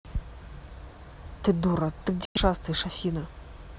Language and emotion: Russian, angry